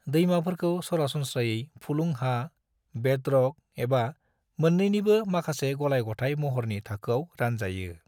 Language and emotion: Bodo, neutral